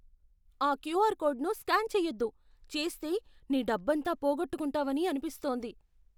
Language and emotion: Telugu, fearful